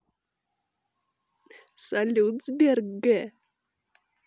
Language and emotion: Russian, positive